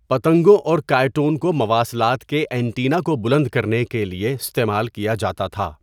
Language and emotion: Urdu, neutral